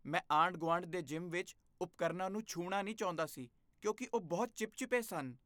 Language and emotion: Punjabi, disgusted